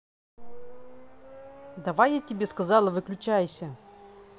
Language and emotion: Russian, angry